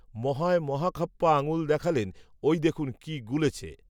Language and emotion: Bengali, neutral